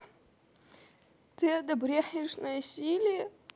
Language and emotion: Russian, sad